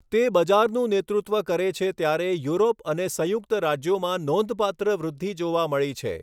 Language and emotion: Gujarati, neutral